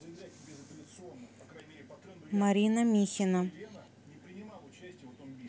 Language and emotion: Russian, neutral